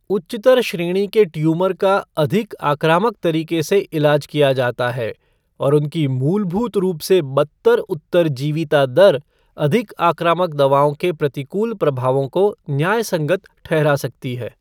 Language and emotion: Hindi, neutral